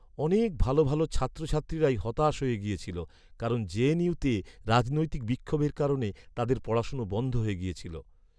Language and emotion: Bengali, sad